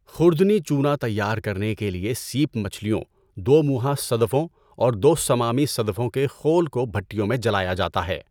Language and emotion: Urdu, neutral